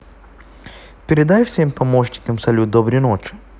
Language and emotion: Russian, neutral